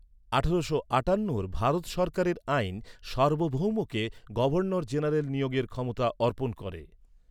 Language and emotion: Bengali, neutral